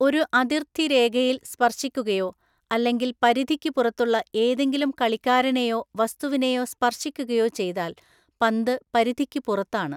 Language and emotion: Malayalam, neutral